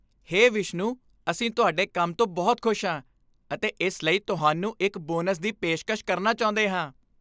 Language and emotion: Punjabi, happy